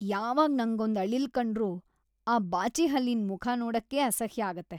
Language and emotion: Kannada, disgusted